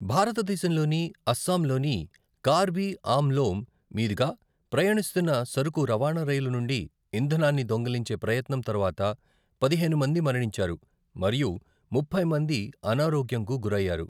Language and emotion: Telugu, neutral